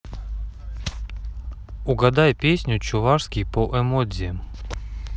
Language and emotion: Russian, neutral